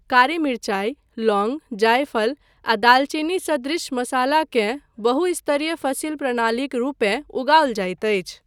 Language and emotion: Maithili, neutral